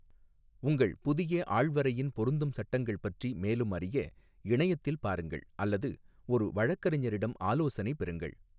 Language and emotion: Tamil, neutral